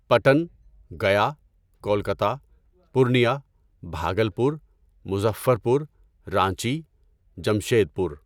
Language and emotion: Urdu, neutral